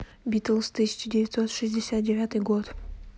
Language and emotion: Russian, neutral